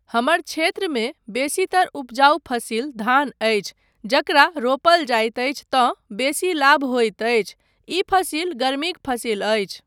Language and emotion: Maithili, neutral